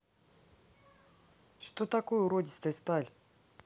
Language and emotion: Russian, neutral